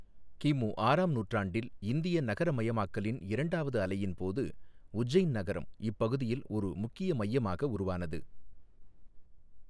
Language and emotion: Tamil, neutral